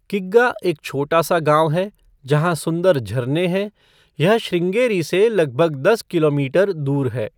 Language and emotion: Hindi, neutral